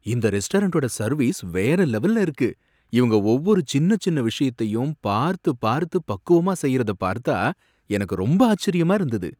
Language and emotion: Tamil, surprised